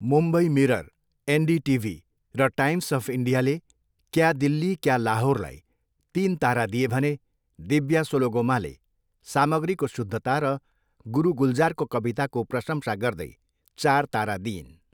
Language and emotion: Nepali, neutral